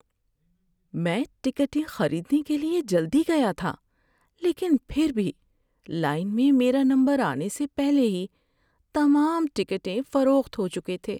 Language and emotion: Urdu, sad